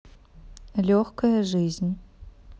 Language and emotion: Russian, neutral